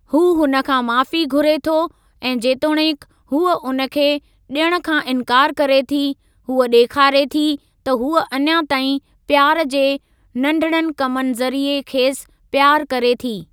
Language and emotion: Sindhi, neutral